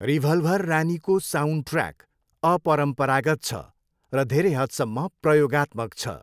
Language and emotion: Nepali, neutral